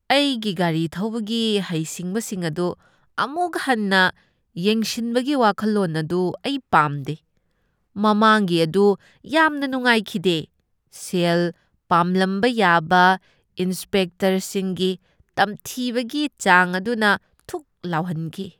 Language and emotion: Manipuri, disgusted